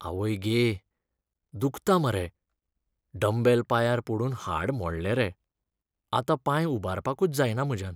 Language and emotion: Goan Konkani, sad